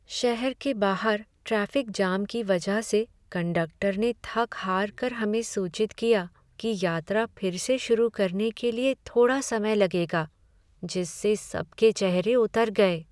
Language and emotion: Hindi, sad